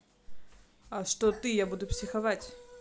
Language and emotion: Russian, neutral